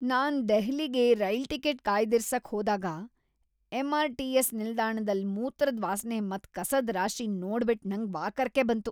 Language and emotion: Kannada, disgusted